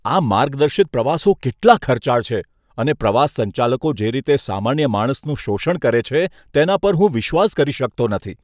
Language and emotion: Gujarati, disgusted